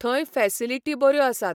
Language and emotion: Goan Konkani, neutral